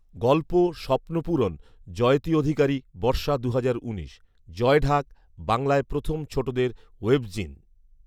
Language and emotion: Bengali, neutral